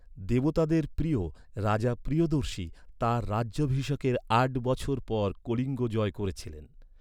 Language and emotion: Bengali, neutral